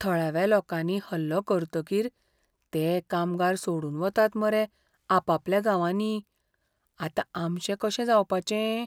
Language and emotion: Goan Konkani, fearful